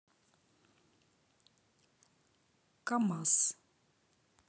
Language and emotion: Russian, neutral